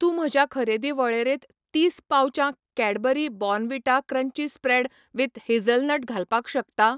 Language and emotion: Goan Konkani, neutral